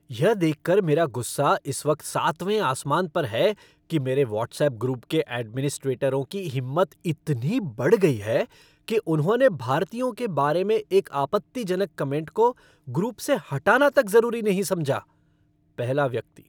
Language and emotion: Hindi, angry